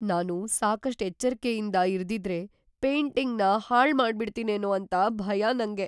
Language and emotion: Kannada, fearful